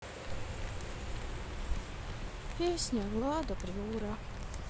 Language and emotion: Russian, sad